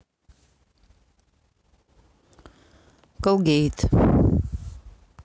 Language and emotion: Russian, neutral